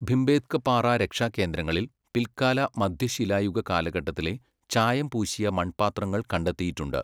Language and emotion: Malayalam, neutral